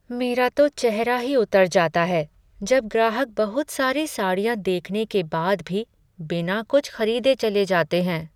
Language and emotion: Hindi, sad